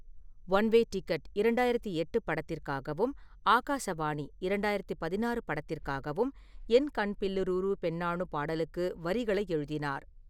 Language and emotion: Tamil, neutral